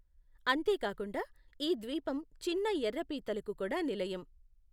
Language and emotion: Telugu, neutral